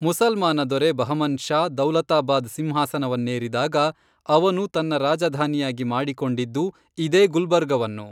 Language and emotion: Kannada, neutral